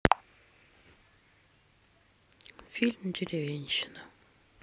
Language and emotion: Russian, sad